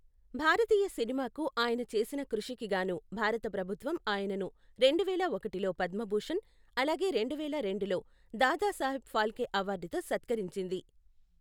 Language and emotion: Telugu, neutral